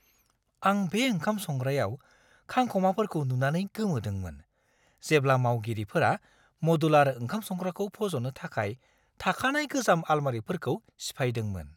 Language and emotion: Bodo, surprised